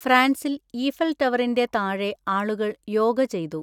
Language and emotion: Malayalam, neutral